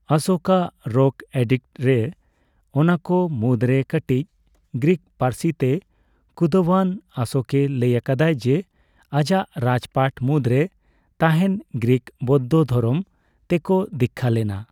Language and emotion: Santali, neutral